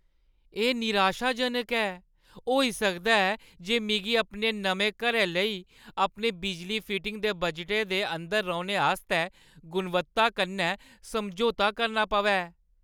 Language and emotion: Dogri, sad